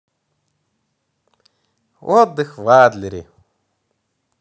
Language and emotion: Russian, positive